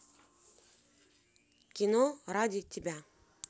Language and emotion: Russian, positive